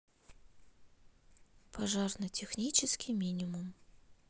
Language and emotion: Russian, neutral